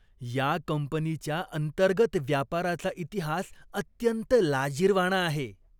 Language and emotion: Marathi, disgusted